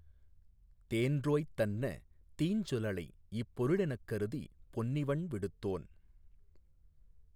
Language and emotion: Tamil, neutral